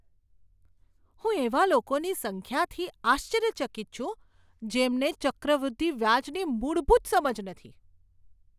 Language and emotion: Gujarati, surprised